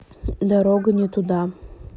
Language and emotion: Russian, neutral